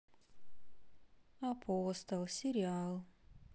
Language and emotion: Russian, sad